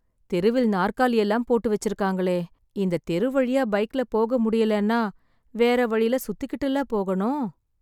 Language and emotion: Tamil, sad